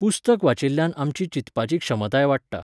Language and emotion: Goan Konkani, neutral